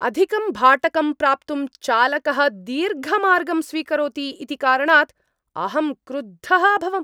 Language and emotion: Sanskrit, angry